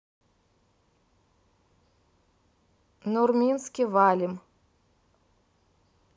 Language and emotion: Russian, neutral